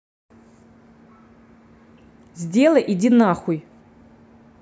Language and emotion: Russian, angry